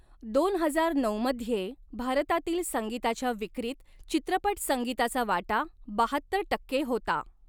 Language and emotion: Marathi, neutral